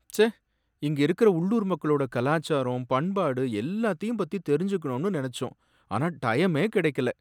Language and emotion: Tamil, sad